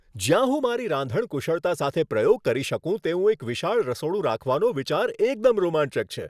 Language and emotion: Gujarati, happy